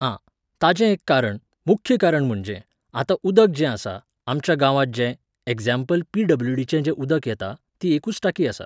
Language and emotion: Goan Konkani, neutral